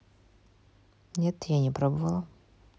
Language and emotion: Russian, neutral